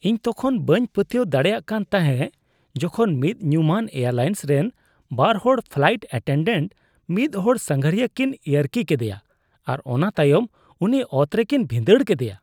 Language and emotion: Santali, disgusted